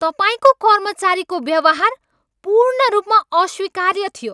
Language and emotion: Nepali, angry